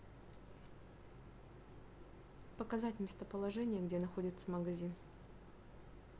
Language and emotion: Russian, neutral